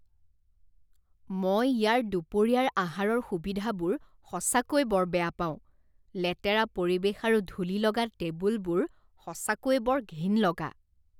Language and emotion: Assamese, disgusted